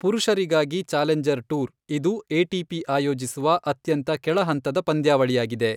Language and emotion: Kannada, neutral